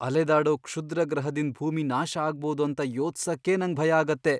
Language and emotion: Kannada, fearful